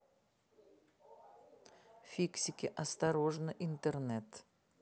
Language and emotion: Russian, neutral